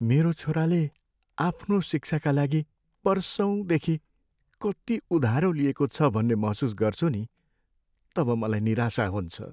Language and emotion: Nepali, sad